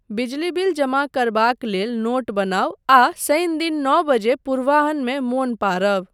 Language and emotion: Maithili, neutral